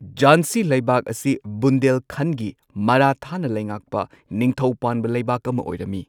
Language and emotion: Manipuri, neutral